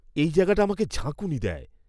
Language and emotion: Bengali, disgusted